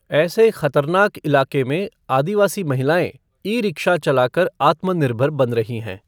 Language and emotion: Hindi, neutral